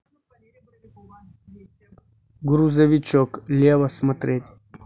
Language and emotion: Russian, neutral